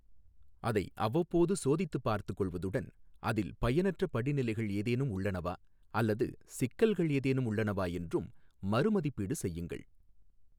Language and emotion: Tamil, neutral